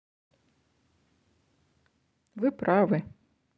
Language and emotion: Russian, neutral